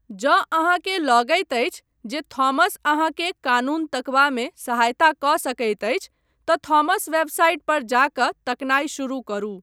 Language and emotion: Maithili, neutral